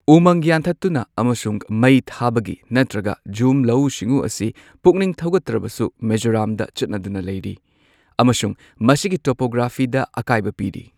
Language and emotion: Manipuri, neutral